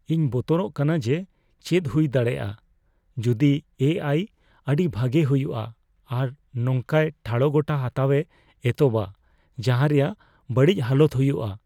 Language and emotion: Santali, fearful